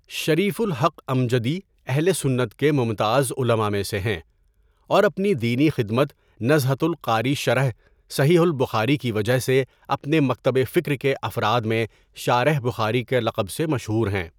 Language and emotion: Urdu, neutral